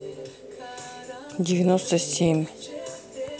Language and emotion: Russian, neutral